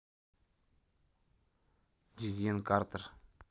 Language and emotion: Russian, neutral